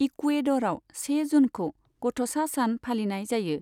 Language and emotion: Bodo, neutral